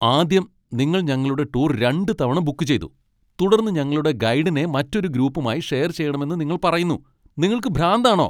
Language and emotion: Malayalam, angry